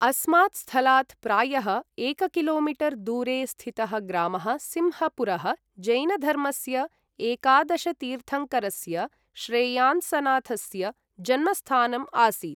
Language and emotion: Sanskrit, neutral